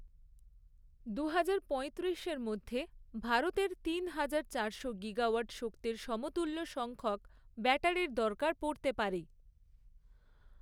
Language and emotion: Bengali, neutral